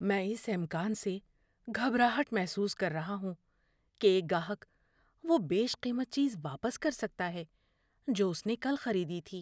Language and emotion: Urdu, fearful